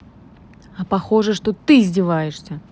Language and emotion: Russian, angry